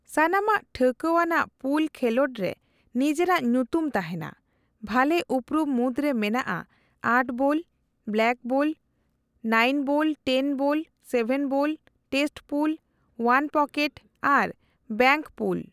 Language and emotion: Santali, neutral